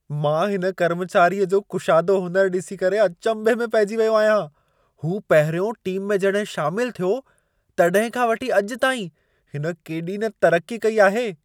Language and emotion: Sindhi, surprised